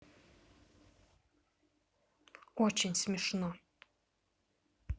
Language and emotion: Russian, angry